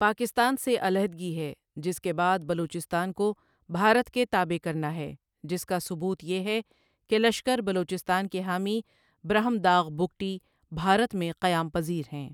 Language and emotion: Urdu, neutral